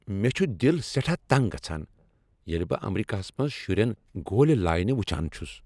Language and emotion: Kashmiri, angry